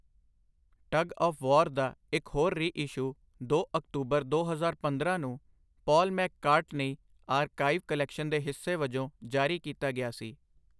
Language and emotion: Punjabi, neutral